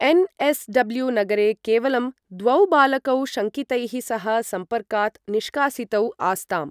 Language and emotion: Sanskrit, neutral